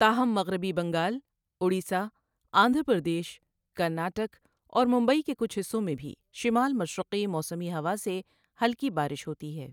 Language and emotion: Urdu, neutral